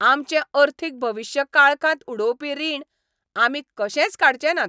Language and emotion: Goan Konkani, angry